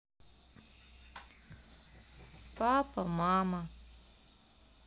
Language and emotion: Russian, sad